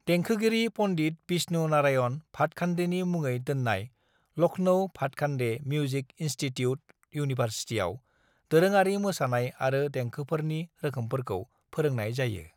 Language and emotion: Bodo, neutral